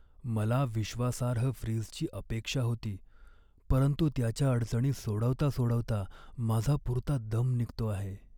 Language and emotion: Marathi, sad